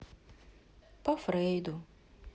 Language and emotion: Russian, sad